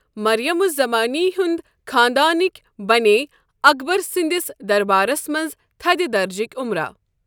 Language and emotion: Kashmiri, neutral